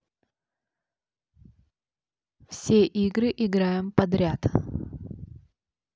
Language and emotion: Russian, neutral